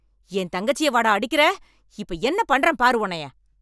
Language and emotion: Tamil, angry